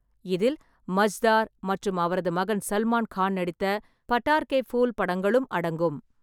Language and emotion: Tamil, neutral